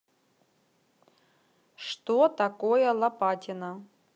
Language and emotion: Russian, neutral